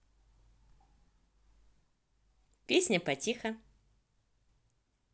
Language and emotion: Russian, positive